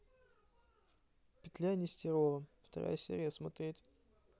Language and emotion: Russian, neutral